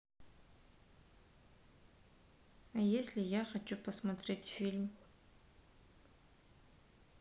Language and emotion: Russian, neutral